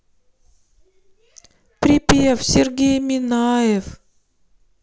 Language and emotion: Russian, sad